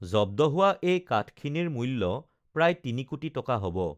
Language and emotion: Assamese, neutral